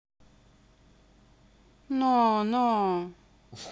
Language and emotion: Russian, neutral